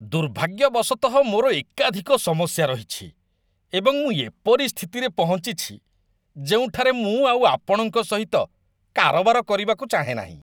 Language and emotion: Odia, disgusted